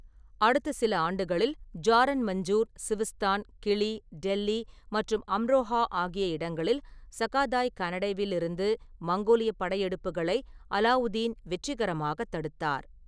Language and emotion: Tamil, neutral